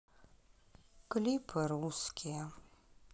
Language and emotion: Russian, sad